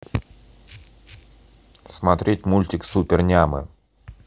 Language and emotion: Russian, neutral